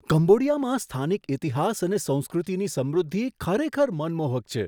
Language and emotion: Gujarati, surprised